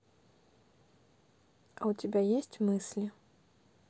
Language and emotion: Russian, neutral